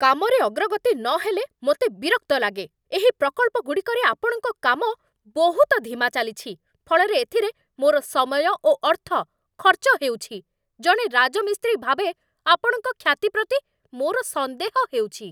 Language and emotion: Odia, angry